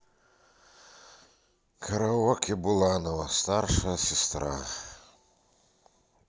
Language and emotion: Russian, sad